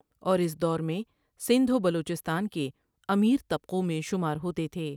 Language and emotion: Urdu, neutral